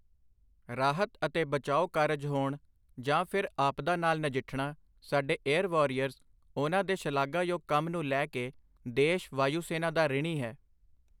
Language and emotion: Punjabi, neutral